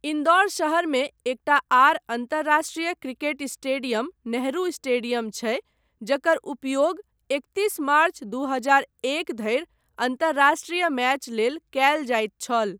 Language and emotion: Maithili, neutral